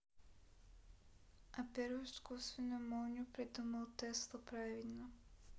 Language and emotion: Russian, neutral